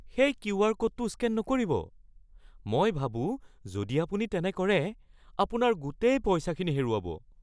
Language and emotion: Assamese, fearful